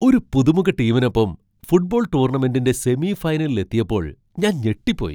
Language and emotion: Malayalam, surprised